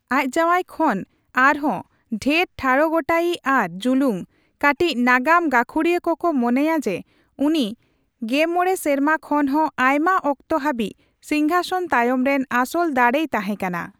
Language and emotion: Santali, neutral